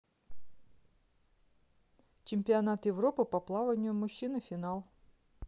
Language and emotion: Russian, neutral